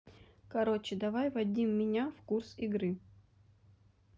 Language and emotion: Russian, neutral